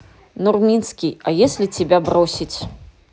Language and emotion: Russian, neutral